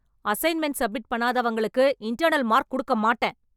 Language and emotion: Tamil, angry